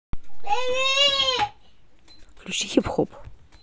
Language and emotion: Russian, neutral